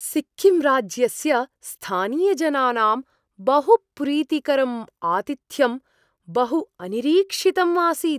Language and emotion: Sanskrit, surprised